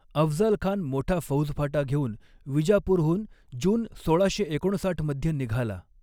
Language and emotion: Marathi, neutral